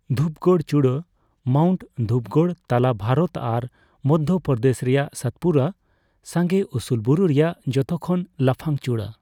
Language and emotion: Santali, neutral